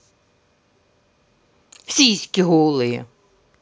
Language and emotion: Russian, angry